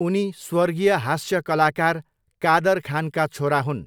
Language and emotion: Nepali, neutral